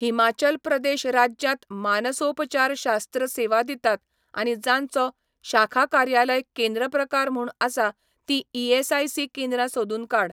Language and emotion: Goan Konkani, neutral